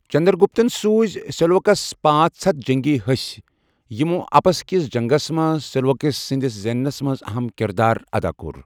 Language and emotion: Kashmiri, neutral